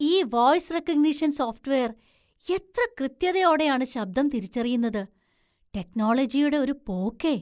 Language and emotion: Malayalam, surprised